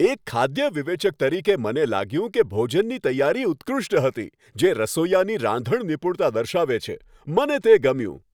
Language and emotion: Gujarati, happy